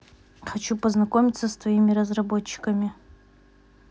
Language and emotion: Russian, neutral